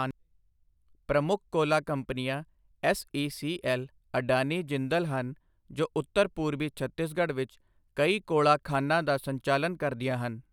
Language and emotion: Punjabi, neutral